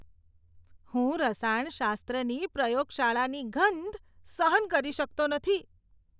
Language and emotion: Gujarati, disgusted